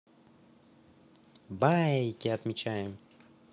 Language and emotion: Russian, positive